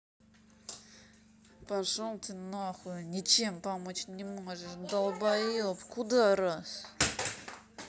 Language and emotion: Russian, angry